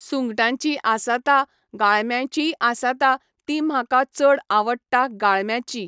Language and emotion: Goan Konkani, neutral